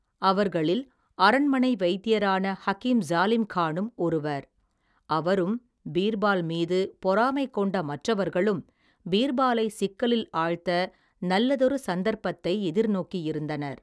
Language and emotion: Tamil, neutral